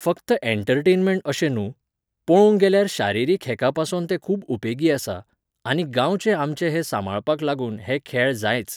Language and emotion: Goan Konkani, neutral